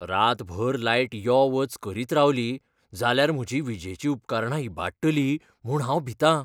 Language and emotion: Goan Konkani, fearful